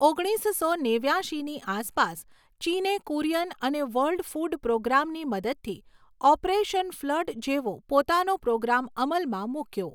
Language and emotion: Gujarati, neutral